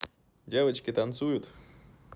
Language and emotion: Russian, positive